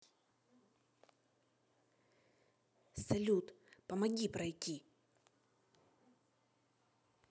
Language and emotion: Russian, neutral